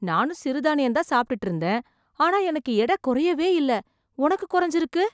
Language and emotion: Tamil, surprised